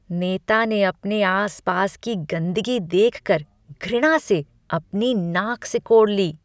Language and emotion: Hindi, disgusted